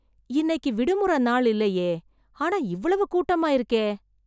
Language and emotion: Tamil, surprised